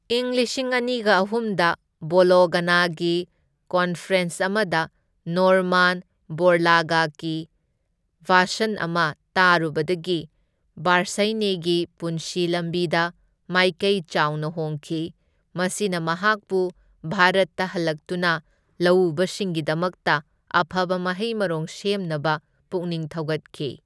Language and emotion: Manipuri, neutral